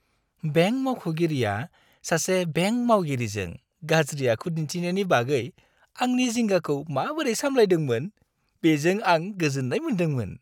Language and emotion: Bodo, happy